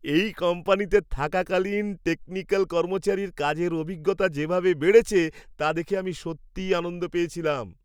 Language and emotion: Bengali, happy